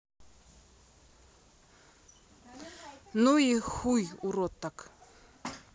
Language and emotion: Russian, neutral